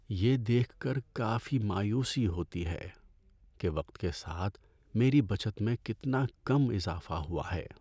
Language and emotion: Urdu, sad